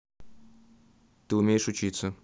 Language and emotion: Russian, neutral